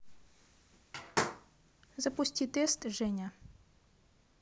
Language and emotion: Russian, neutral